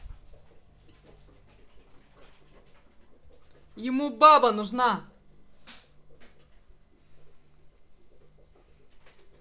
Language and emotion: Russian, angry